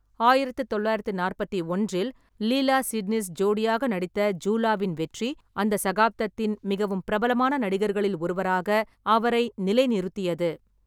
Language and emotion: Tamil, neutral